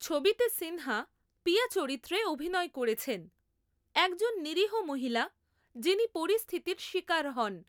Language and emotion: Bengali, neutral